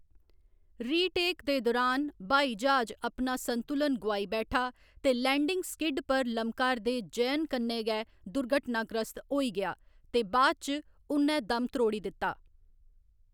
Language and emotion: Dogri, neutral